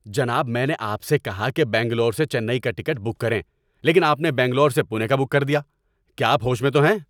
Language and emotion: Urdu, angry